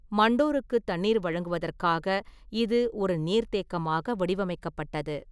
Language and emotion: Tamil, neutral